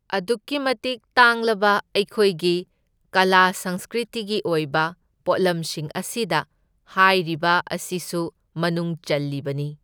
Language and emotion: Manipuri, neutral